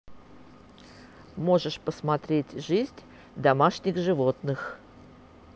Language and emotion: Russian, neutral